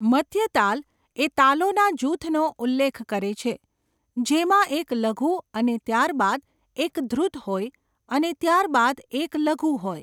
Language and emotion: Gujarati, neutral